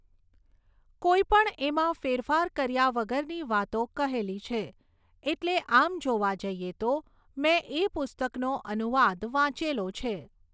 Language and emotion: Gujarati, neutral